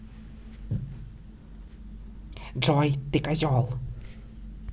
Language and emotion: Russian, angry